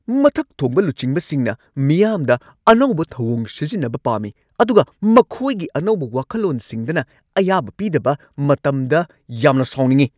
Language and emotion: Manipuri, angry